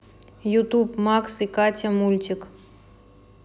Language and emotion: Russian, neutral